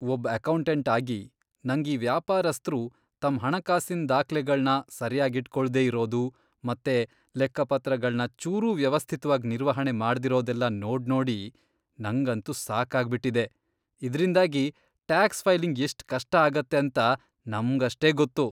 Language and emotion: Kannada, disgusted